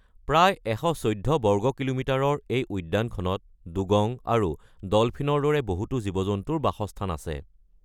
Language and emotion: Assamese, neutral